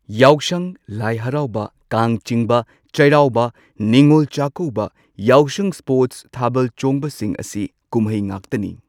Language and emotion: Manipuri, neutral